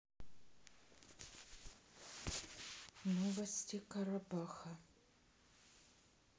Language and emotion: Russian, sad